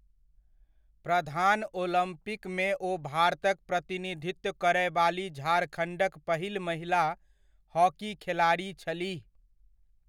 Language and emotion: Maithili, neutral